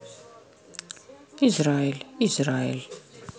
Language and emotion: Russian, neutral